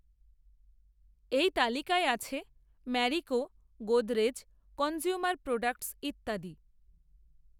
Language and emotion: Bengali, neutral